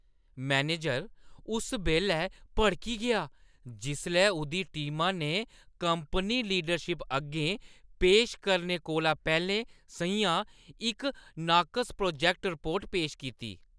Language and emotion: Dogri, angry